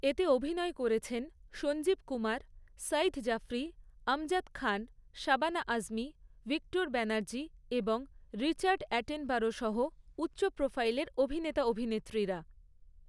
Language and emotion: Bengali, neutral